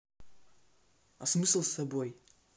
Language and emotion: Russian, neutral